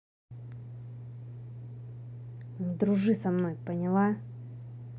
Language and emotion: Russian, angry